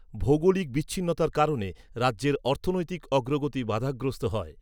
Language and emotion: Bengali, neutral